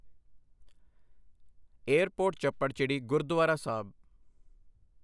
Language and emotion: Punjabi, neutral